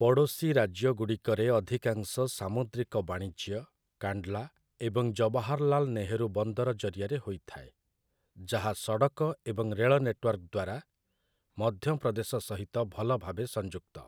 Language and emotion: Odia, neutral